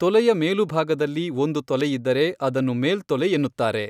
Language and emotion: Kannada, neutral